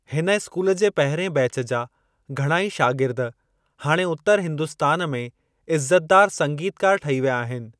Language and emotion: Sindhi, neutral